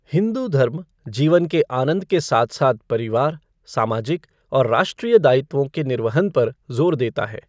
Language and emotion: Hindi, neutral